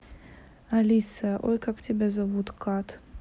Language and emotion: Russian, neutral